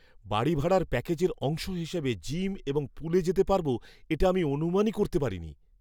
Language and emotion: Bengali, surprised